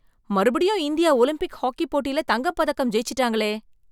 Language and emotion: Tamil, surprised